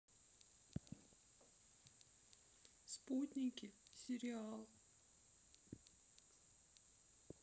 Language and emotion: Russian, sad